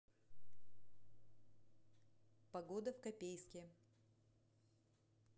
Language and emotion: Russian, neutral